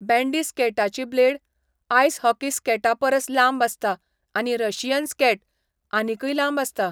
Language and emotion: Goan Konkani, neutral